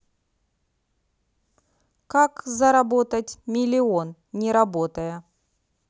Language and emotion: Russian, neutral